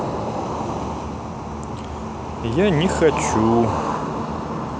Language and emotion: Russian, neutral